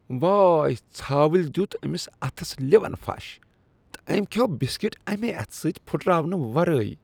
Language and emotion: Kashmiri, disgusted